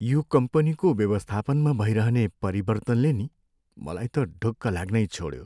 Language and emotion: Nepali, sad